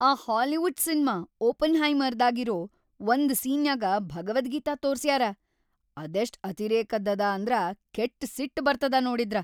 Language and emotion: Kannada, angry